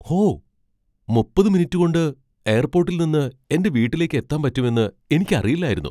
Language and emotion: Malayalam, surprised